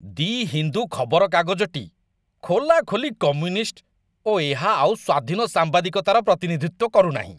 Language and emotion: Odia, disgusted